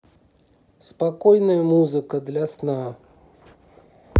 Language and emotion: Russian, neutral